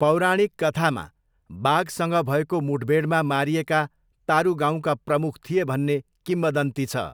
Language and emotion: Nepali, neutral